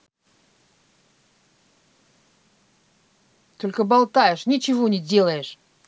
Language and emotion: Russian, angry